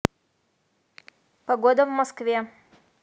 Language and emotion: Russian, neutral